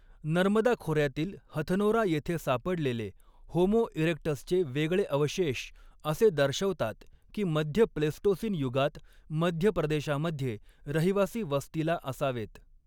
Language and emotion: Marathi, neutral